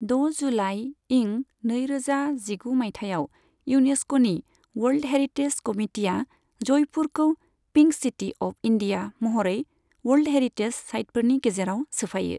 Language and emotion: Bodo, neutral